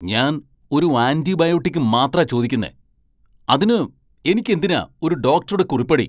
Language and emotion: Malayalam, angry